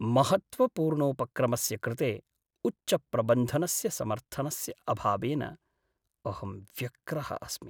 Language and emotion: Sanskrit, sad